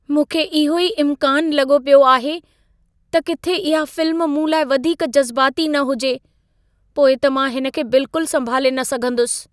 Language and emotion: Sindhi, fearful